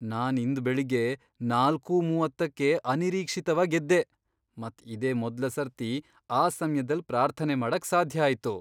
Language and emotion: Kannada, surprised